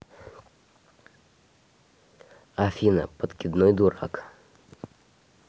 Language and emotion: Russian, neutral